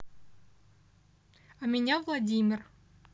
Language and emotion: Russian, neutral